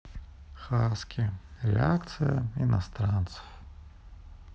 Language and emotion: Russian, sad